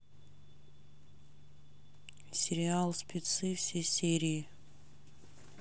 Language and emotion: Russian, neutral